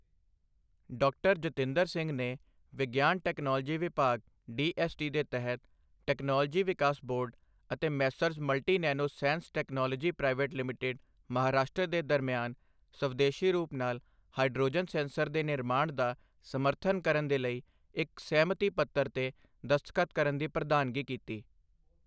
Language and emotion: Punjabi, neutral